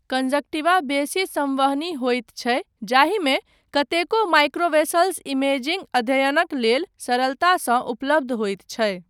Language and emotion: Maithili, neutral